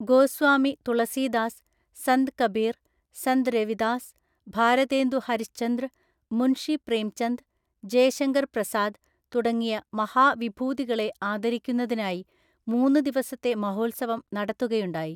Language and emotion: Malayalam, neutral